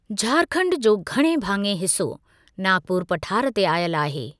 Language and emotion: Sindhi, neutral